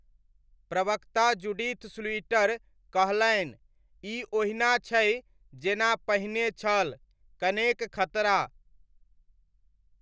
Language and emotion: Maithili, neutral